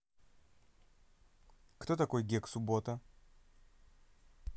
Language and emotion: Russian, neutral